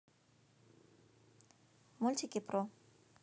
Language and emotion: Russian, neutral